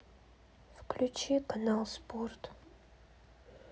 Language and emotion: Russian, sad